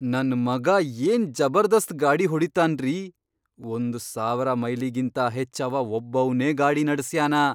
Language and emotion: Kannada, surprised